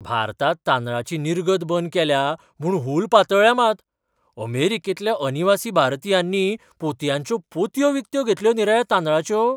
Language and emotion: Goan Konkani, surprised